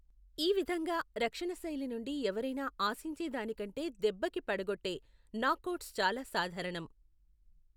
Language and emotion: Telugu, neutral